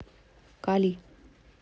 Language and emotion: Russian, neutral